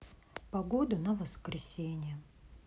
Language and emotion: Russian, sad